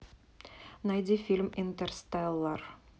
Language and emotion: Russian, neutral